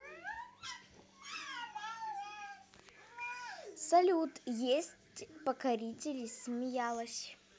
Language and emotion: Russian, positive